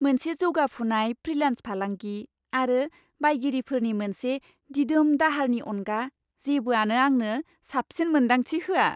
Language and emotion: Bodo, happy